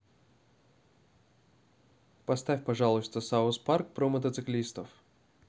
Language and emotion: Russian, neutral